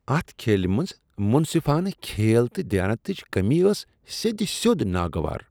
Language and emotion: Kashmiri, disgusted